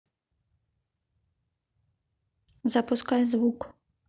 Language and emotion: Russian, neutral